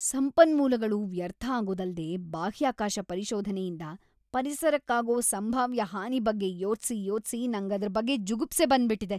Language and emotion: Kannada, disgusted